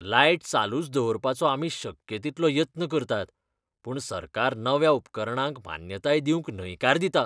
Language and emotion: Goan Konkani, disgusted